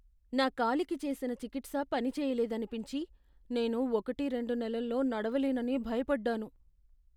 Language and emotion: Telugu, fearful